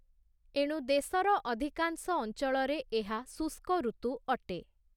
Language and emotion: Odia, neutral